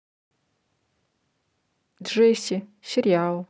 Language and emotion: Russian, neutral